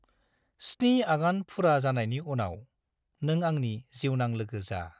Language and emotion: Bodo, neutral